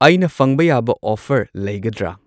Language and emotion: Manipuri, neutral